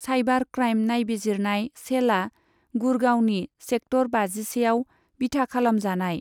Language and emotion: Bodo, neutral